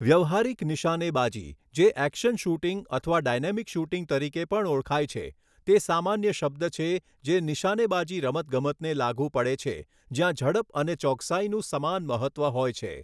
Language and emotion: Gujarati, neutral